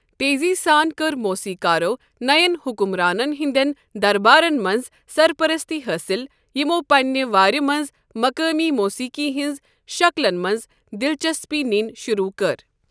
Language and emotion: Kashmiri, neutral